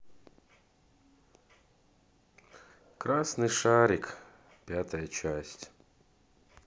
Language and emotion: Russian, sad